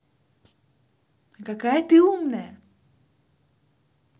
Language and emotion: Russian, positive